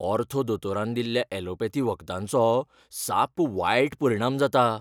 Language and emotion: Goan Konkani, fearful